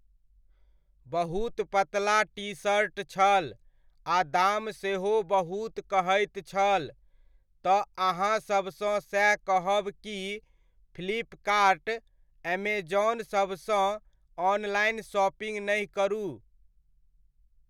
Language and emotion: Maithili, neutral